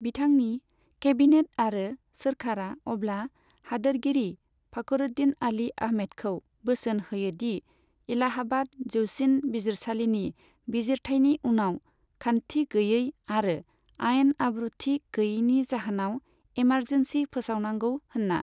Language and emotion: Bodo, neutral